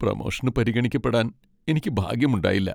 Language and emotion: Malayalam, sad